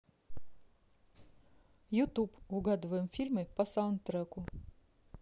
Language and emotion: Russian, neutral